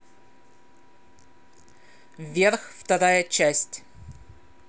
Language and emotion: Russian, neutral